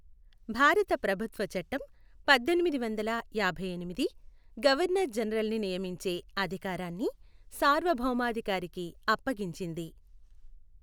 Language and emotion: Telugu, neutral